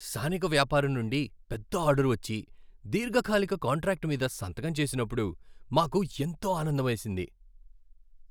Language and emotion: Telugu, happy